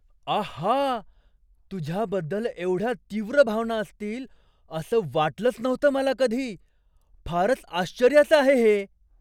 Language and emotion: Marathi, surprised